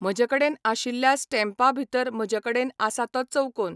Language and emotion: Goan Konkani, neutral